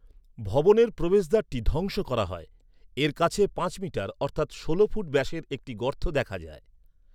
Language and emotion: Bengali, neutral